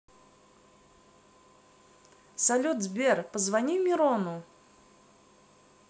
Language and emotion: Russian, positive